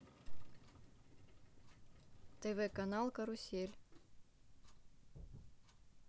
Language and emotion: Russian, neutral